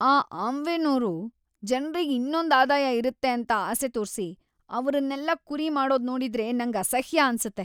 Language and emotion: Kannada, disgusted